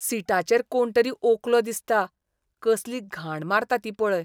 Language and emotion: Goan Konkani, disgusted